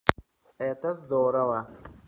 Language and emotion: Russian, positive